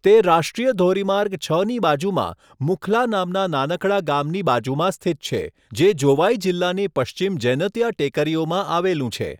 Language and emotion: Gujarati, neutral